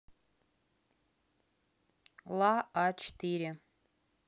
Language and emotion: Russian, neutral